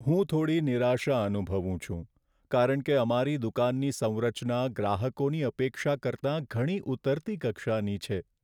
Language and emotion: Gujarati, sad